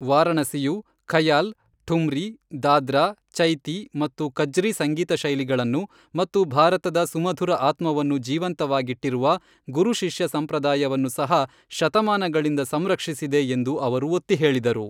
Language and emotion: Kannada, neutral